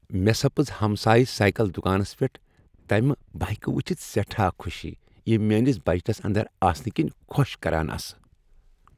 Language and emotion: Kashmiri, happy